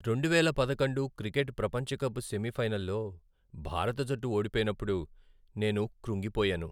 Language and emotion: Telugu, sad